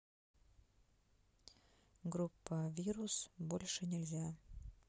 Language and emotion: Russian, sad